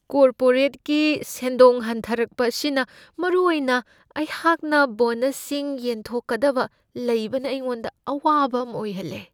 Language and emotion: Manipuri, fearful